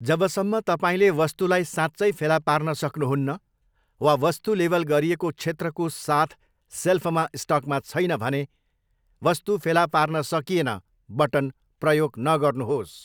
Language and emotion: Nepali, neutral